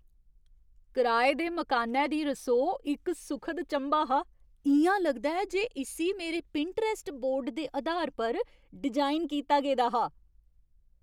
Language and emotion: Dogri, surprised